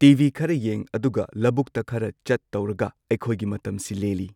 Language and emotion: Manipuri, neutral